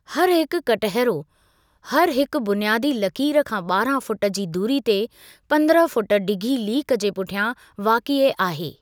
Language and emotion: Sindhi, neutral